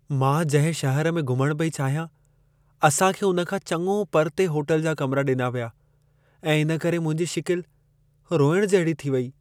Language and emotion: Sindhi, sad